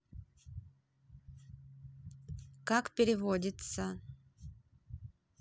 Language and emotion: Russian, neutral